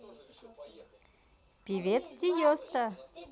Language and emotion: Russian, positive